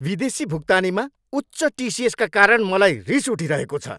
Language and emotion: Nepali, angry